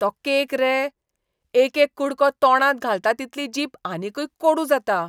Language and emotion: Goan Konkani, disgusted